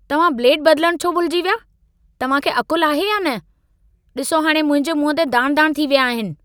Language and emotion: Sindhi, angry